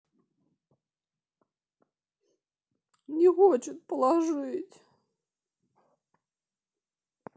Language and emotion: Russian, sad